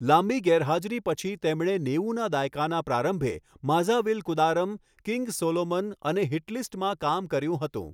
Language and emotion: Gujarati, neutral